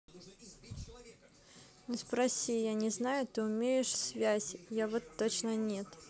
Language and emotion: Russian, neutral